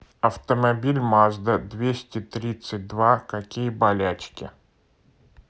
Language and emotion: Russian, neutral